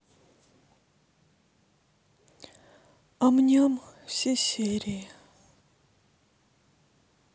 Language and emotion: Russian, sad